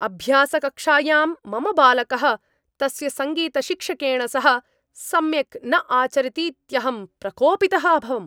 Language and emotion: Sanskrit, angry